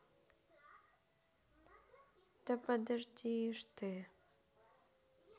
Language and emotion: Russian, sad